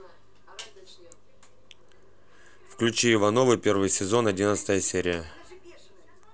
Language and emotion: Russian, neutral